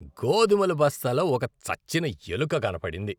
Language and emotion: Telugu, disgusted